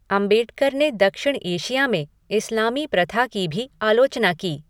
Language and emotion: Hindi, neutral